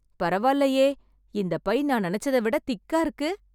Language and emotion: Tamil, surprised